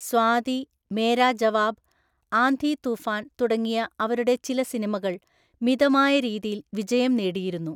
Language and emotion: Malayalam, neutral